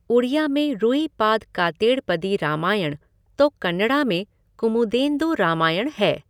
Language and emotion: Hindi, neutral